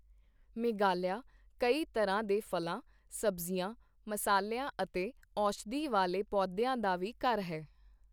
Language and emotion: Punjabi, neutral